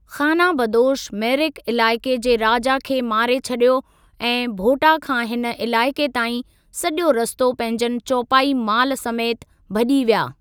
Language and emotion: Sindhi, neutral